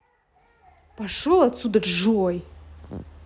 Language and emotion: Russian, angry